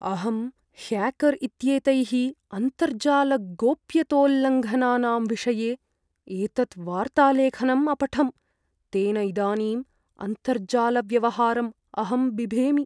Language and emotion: Sanskrit, fearful